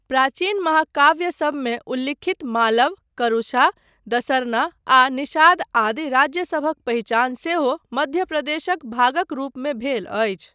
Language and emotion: Maithili, neutral